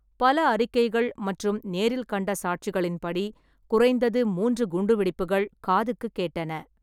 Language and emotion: Tamil, neutral